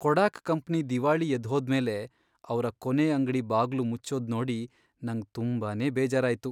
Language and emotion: Kannada, sad